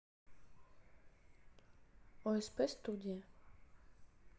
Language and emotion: Russian, neutral